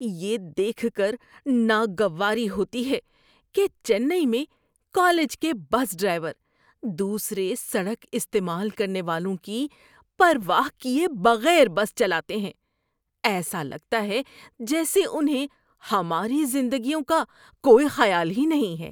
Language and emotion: Urdu, disgusted